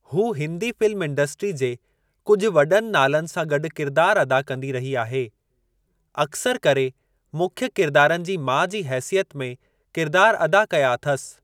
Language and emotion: Sindhi, neutral